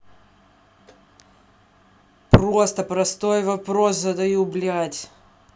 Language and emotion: Russian, angry